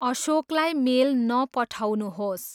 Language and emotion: Nepali, neutral